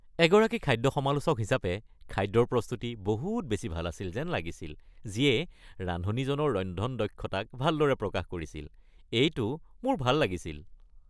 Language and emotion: Assamese, happy